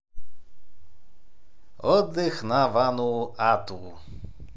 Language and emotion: Russian, positive